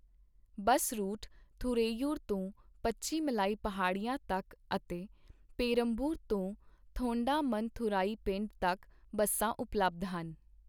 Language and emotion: Punjabi, neutral